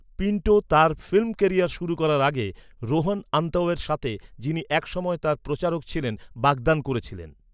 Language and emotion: Bengali, neutral